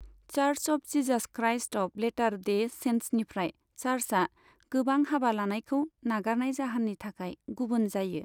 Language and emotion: Bodo, neutral